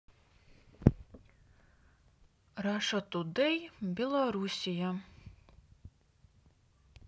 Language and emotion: Russian, neutral